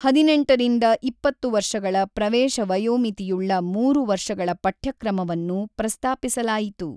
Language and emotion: Kannada, neutral